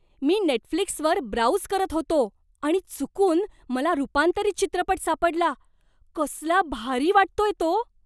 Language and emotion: Marathi, surprised